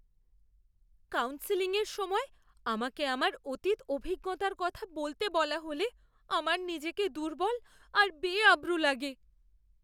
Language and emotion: Bengali, fearful